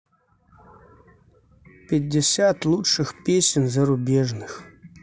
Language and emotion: Russian, neutral